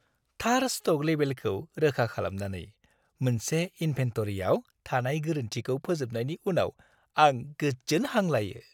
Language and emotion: Bodo, happy